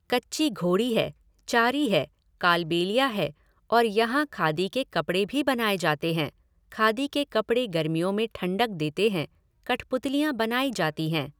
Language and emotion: Hindi, neutral